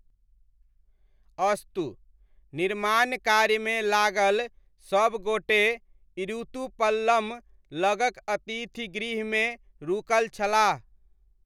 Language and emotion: Maithili, neutral